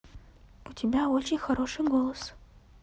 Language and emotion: Russian, neutral